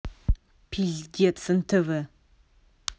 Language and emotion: Russian, angry